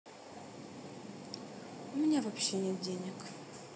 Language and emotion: Russian, sad